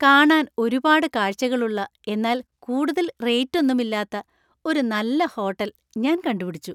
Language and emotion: Malayalam, happy